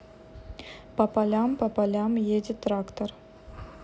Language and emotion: Russian, neutral